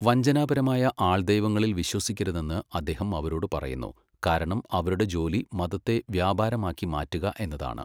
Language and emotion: Malayalam, neutral